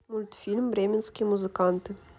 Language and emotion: Russian, neutral